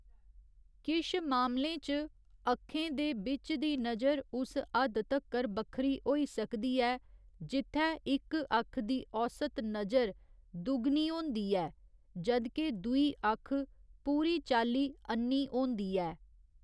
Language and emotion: Dogri, neutral